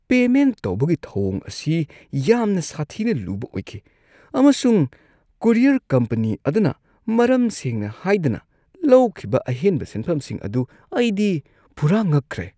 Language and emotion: Manipuri, disgusted